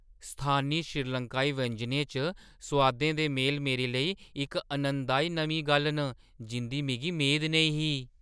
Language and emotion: Dogri, surprised